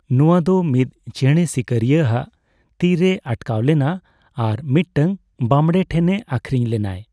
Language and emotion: Santali, neutral